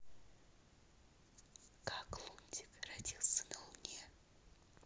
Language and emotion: Russian, neutral